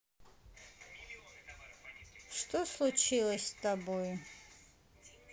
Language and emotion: Russian, neutral